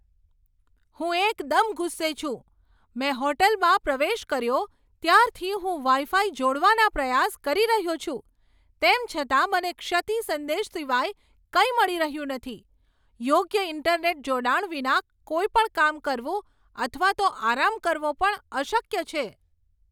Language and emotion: Gujarati, angry